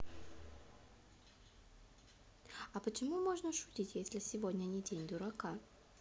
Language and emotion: Russian, neutral